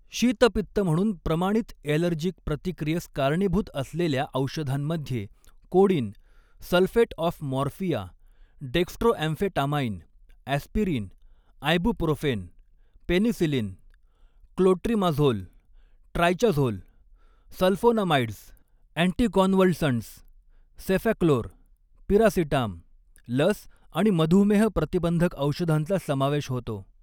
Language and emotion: Marathi, neutral